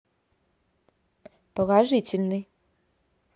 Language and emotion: Russian, neutral